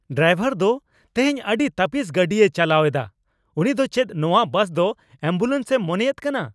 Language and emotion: Santali, angry